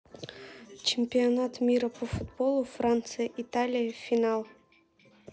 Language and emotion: Russian, neutral